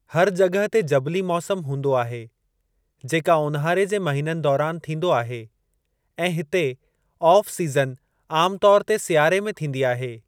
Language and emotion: Sindhi, neutral